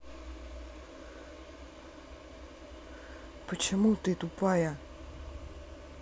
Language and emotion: Russian, angry